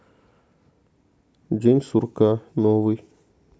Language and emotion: Russian, neutral